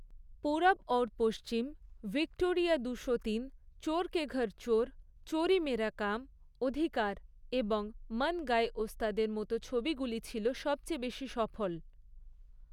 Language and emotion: Bengali, neutral